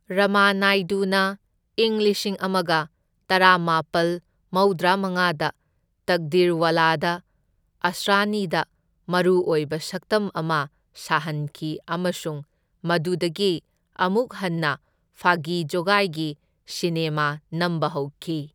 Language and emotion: Manipuri, neutral